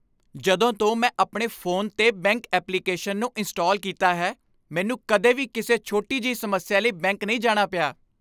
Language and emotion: Punjabi, happy